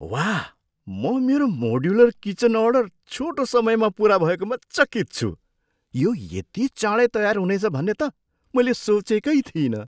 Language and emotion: Nepali, surprised